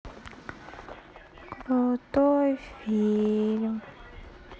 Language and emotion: Russian, sad